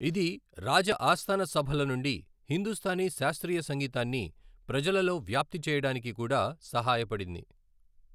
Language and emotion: Telugu, neutral